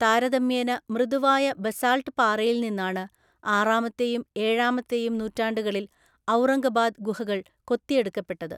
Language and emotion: Malayalam, neutral